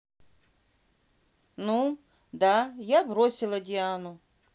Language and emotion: Russian, neutral